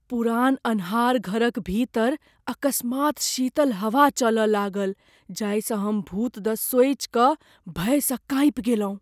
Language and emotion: Maithili, fearful